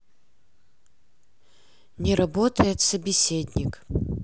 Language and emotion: Russian, neutral